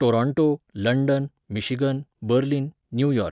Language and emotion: Goan Konkani, neutral